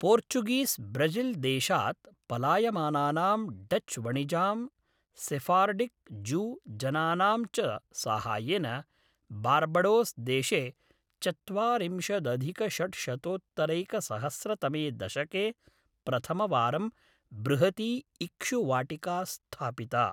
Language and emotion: Sanskrit, neutral